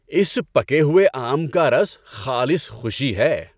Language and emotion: Urdu, happy